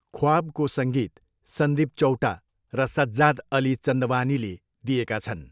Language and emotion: Nepali, neutral